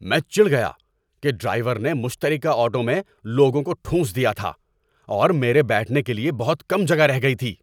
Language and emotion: Urdu, angry